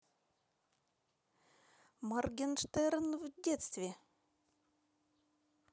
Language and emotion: Russian, neutral